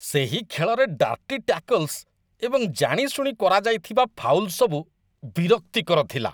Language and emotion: Odia, disgusted